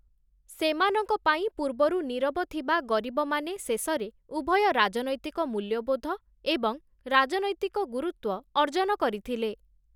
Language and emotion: Odia, neutral